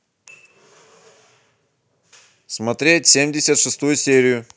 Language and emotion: Russian, neutral